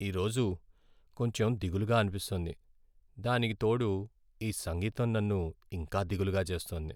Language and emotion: Telugu, sad